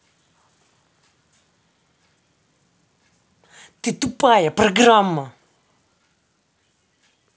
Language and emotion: Russian, angry